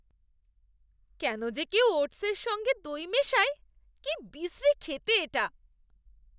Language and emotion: Bengali, disgusted